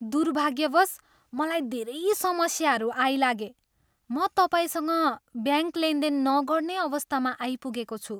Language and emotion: Nepali, disgusted